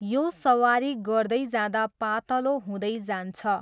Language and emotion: Nepali, neutral